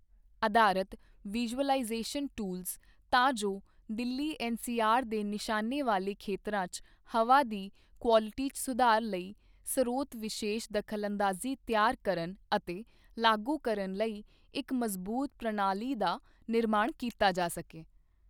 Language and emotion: Punjabi, neutral